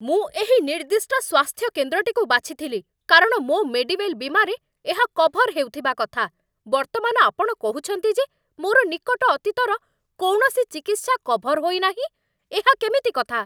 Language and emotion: Odia, angry